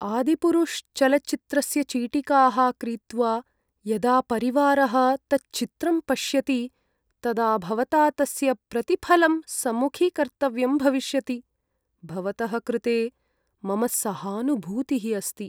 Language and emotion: Sanskrit, sad